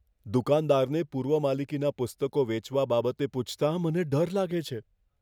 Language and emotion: Gujarati, fearful